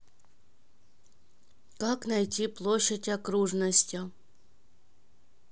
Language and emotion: Russian, neutral